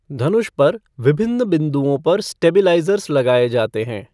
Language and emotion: Hindi, neutral